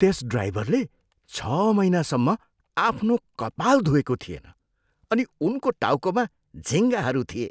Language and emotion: Nepali, disgusted